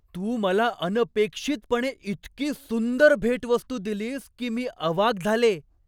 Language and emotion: Marathi, surprised